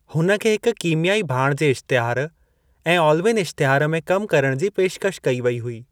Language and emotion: Sindhi, neutral